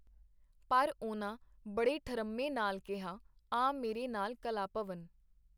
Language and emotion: Punjabi, neutral